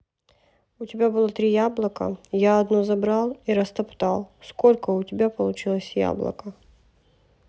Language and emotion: Russian, neutral